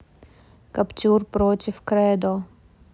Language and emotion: Russian, neutral